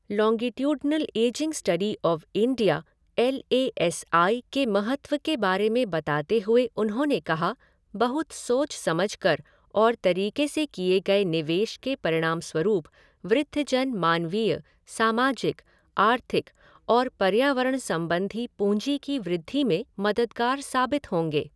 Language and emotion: Hindi, neutral